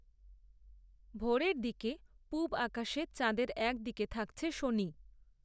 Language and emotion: Bengali, neutral